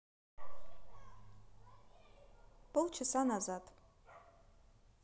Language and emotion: Russian, neutral